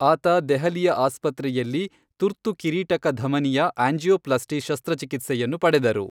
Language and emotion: Kannada, neutral